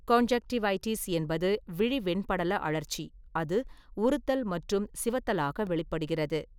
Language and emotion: Tamil, neutral